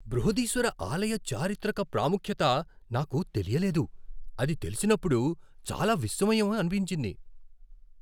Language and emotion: Telugu, surprised